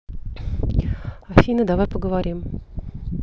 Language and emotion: Russian, neutral